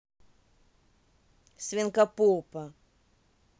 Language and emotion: Russian, neutral